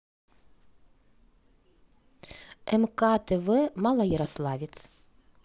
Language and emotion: Russian, neutral